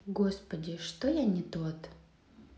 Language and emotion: Russian, sad